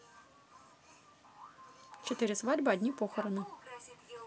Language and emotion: Russian, positive